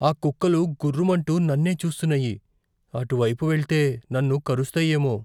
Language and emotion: Telugu, fearful